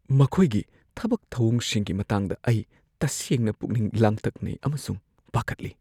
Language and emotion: Manipuri, fearful